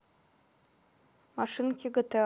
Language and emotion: Russian, neutral